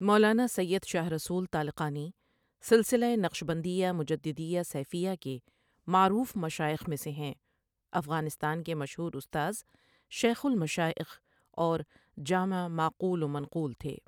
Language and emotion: Urdu, neutral